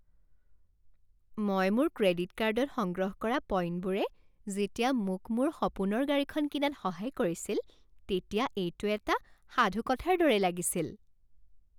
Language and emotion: Assamese, happy